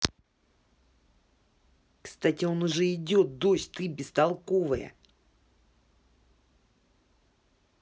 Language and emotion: Russian, angry